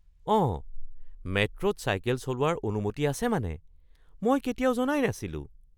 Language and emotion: Assamese, surprised